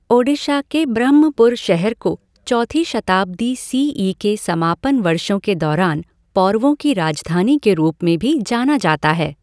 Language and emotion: Hindi, neutral